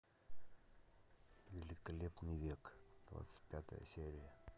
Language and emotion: Russian, neutral